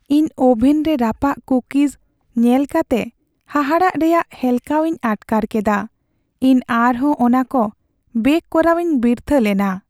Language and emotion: Santali, sad